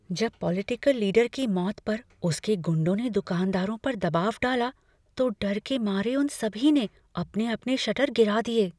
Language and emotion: Hindi, fearful